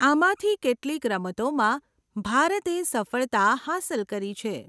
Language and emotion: Gujarati, neutral